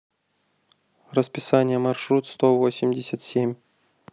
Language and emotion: Russian, neutral